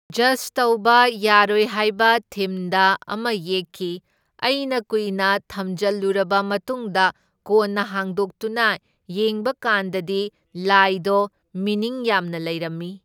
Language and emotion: Manipuri, neutral